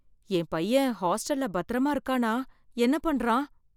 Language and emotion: Tamil, fearful